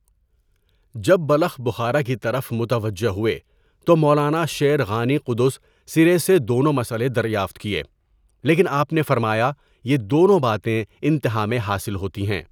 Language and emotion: Urdu, neutral